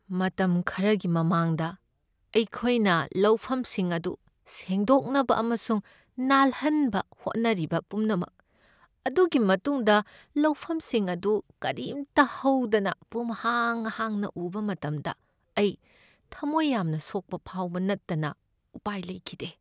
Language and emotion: Manipuri, sad